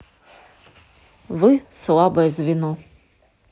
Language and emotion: Russian, neutral